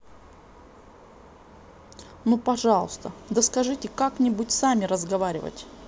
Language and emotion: Russian, neutral